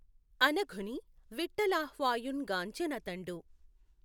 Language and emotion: Telugu, neutral